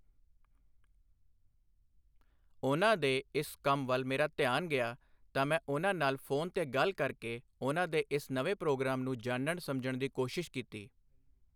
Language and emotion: Punjabi, neutral